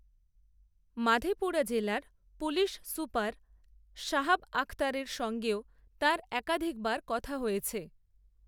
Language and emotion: Bengali, neutral